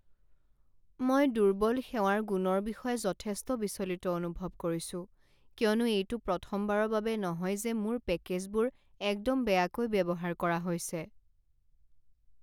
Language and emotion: Assamese, sad